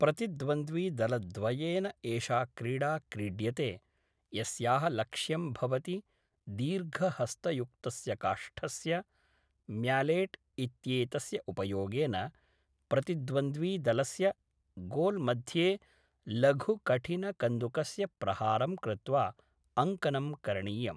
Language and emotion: Sanskrit, neutral